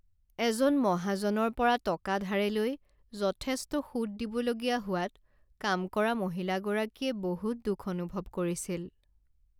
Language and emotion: Assamese, sad